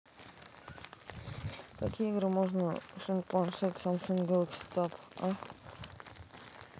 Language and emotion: Russian, neutral